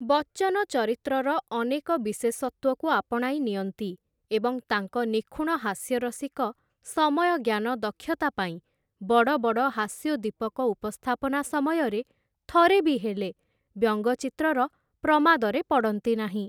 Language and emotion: Odia, neutral